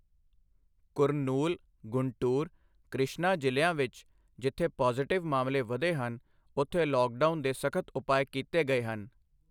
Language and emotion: Punjabi, neutral